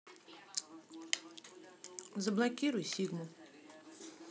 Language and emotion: Russian, neutral